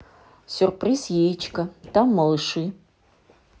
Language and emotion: Russian, neutral